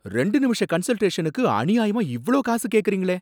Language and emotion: Tamil, angry